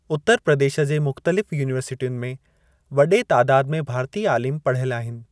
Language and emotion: Sindhi, neutral